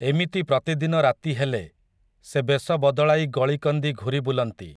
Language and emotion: Odia, neutral